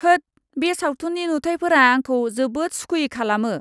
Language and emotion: Bodo, disgusted